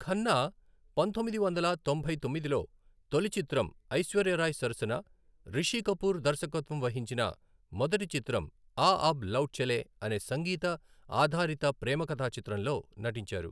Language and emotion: Telugu, neutral